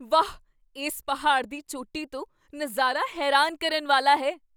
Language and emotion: Punjabi, surprised